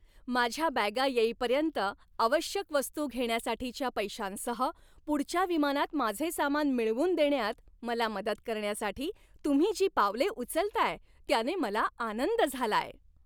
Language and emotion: Marathi, happy